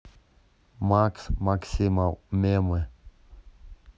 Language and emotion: Russian, neutral